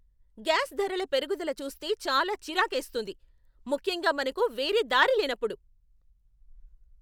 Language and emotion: Telugu, angry